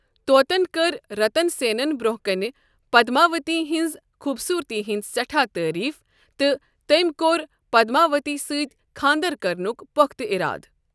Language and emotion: Kashmiri, neutral